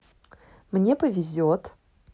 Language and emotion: Russian, positive